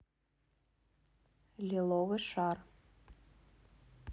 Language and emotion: Russian, neutral